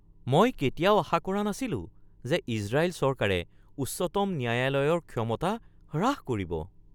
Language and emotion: Assamese, surprised